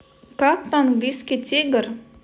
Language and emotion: Russian, neutral